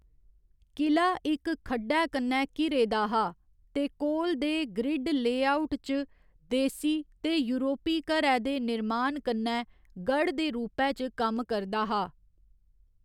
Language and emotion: Dogri, neutral